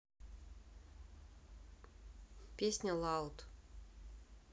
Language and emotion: Russian, neutral